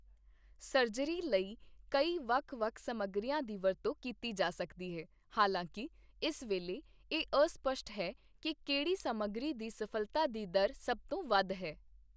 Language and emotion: Punjabi, neutral